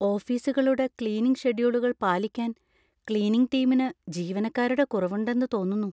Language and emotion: Malayalam, fearful